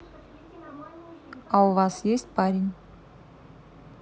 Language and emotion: Russian, neutral